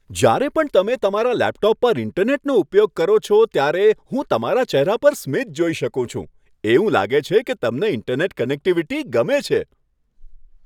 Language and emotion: Gujarati, happy